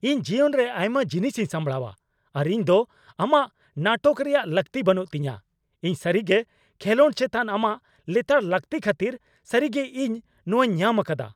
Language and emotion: Santali, angry